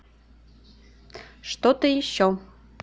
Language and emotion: Russian, neutral